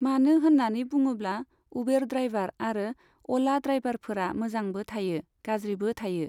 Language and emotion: Bodo, neutral